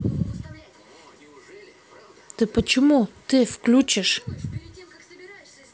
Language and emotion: Russian, angry